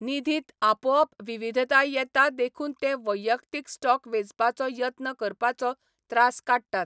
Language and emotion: Goan Konkani, neutral